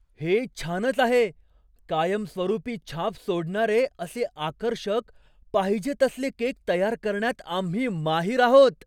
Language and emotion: Marathi, surprised